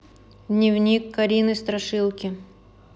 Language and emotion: Russian, neutral